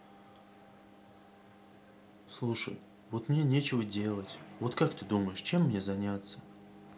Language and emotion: Russian, sad